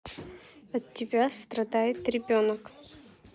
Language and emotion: Russian, neutral